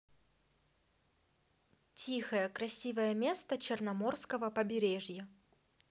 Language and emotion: Russian, positive